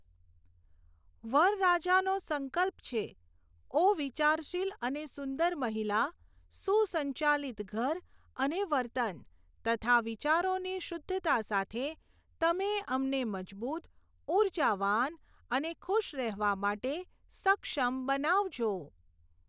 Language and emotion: Gujarati, neutral